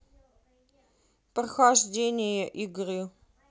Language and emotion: Russian, neutral